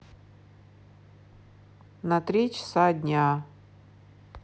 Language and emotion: Russian, sad